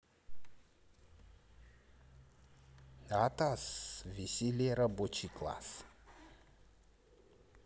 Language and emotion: Russian, neutral